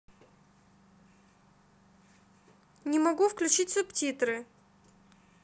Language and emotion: Russian, neutral